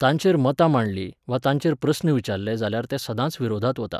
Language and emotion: Goan Konkani, neutral